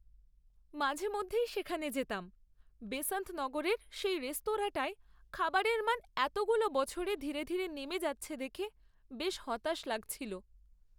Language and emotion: Bengali, sad